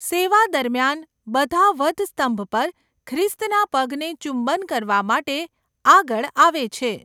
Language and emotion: Gujarati, neutral